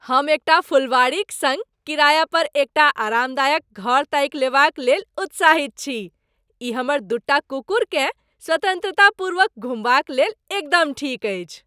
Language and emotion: Maithili, happy